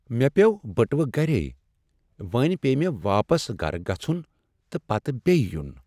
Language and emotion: Kashmiri, sad